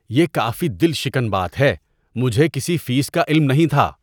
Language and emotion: Urdu, disgusted